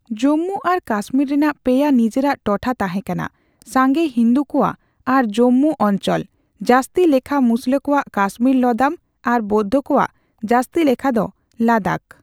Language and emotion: Santali, neutral